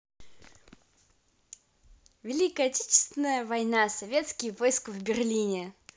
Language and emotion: Russian, positive